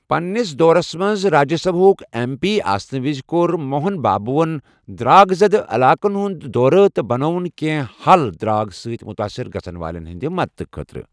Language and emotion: Kashmiri, neutral